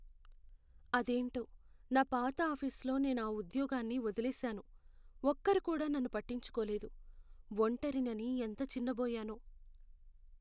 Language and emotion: Telugu, sad